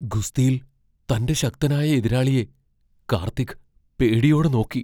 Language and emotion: Malayalam, fearful